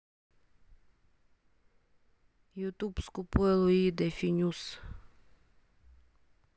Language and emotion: Russian, neutral